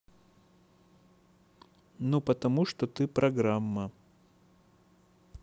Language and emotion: Russian, neutral